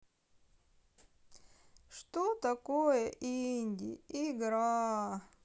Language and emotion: Russian, sad